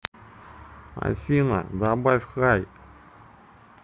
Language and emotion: Russian, neutral